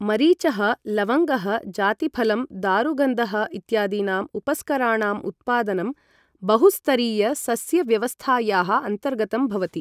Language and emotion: Sanskrit, neutral